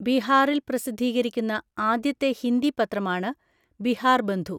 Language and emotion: Malayalam, neutral